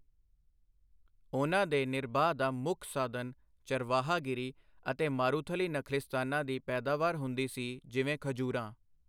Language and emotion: Punjabi, neutral